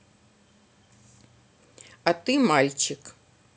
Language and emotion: Russian, neutral